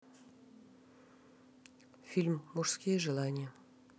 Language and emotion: Russian, neutral